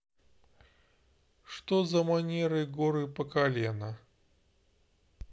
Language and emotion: Russian, neutral